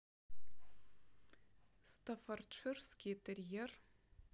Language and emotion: Russian, neutral